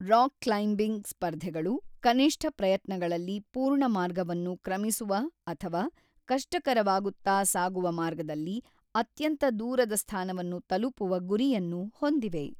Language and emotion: Kannada, neutral